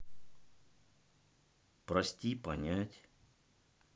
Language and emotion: Russian, sad